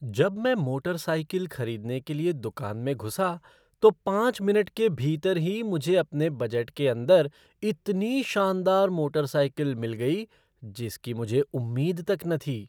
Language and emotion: Hindi, surprised